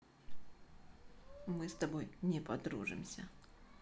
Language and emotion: Russian, neutral